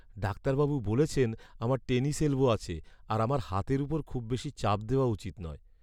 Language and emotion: Bengali, sad